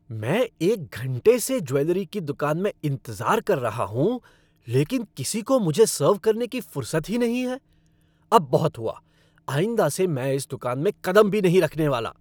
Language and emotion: Hindi, angry